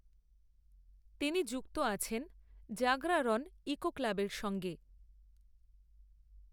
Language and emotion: Bengali, neutral